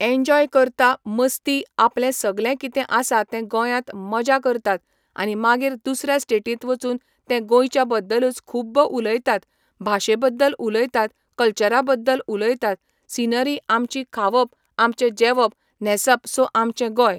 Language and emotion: Goan Konkani, neutral